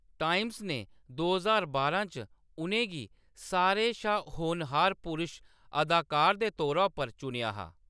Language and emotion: Dogri, neutral